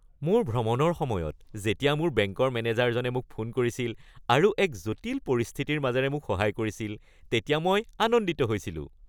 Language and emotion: Assamese, happy